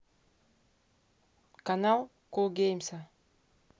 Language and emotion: Russian, neutral